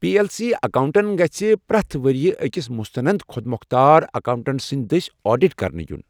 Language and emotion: Kashmiri, neutral